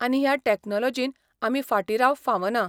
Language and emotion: Goan Konkani, neutral